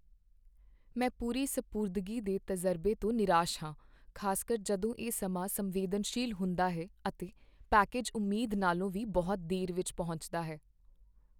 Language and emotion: Punjabi, sad